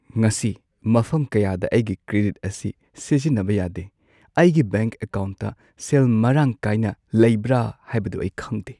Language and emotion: Manipuri, sad